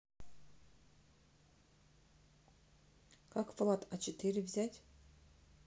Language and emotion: Russian, neutral